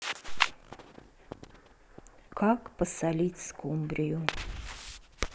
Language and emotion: Russian, neutral